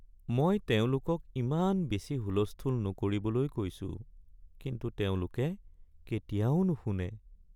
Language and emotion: Assamese, sad